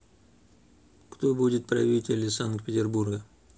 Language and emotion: Russian, neutral